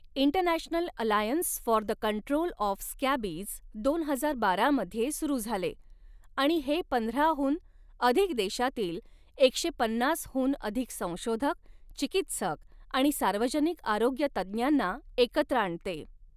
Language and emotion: Marathi, neutral